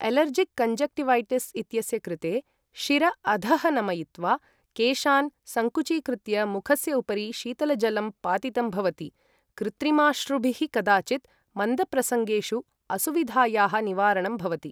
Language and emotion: Sanskrit, neutral